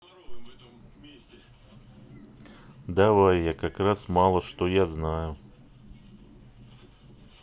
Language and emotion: Russian, neutral